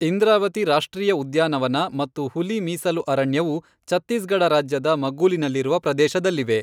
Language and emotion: Kannada, neutral